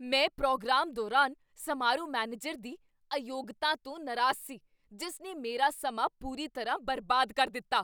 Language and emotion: Punjabi, angry